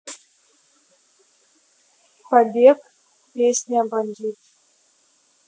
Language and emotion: Russian, neutral